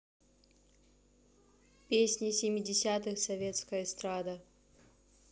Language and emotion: Russian, neutral